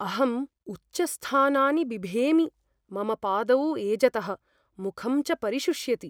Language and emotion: Sanskrit, fearful